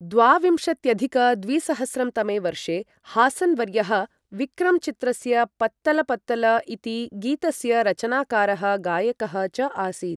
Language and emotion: Sanskrit, neutral